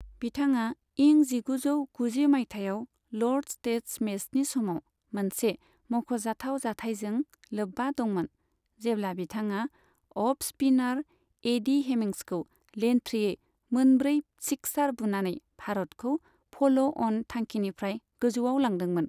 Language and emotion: Bodo, neutral